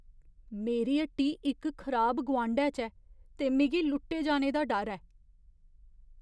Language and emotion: Dogri, fearful